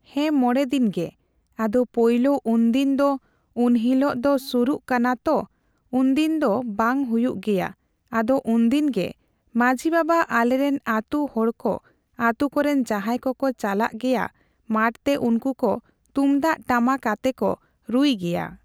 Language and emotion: Santali, neutral